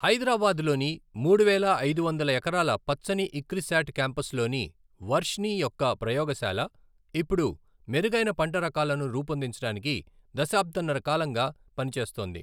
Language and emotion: Telugu, neutral